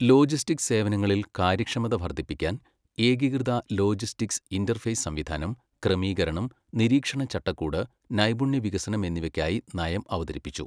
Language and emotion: Malayalam, neutral